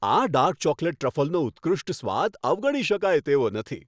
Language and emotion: Gujarati, happy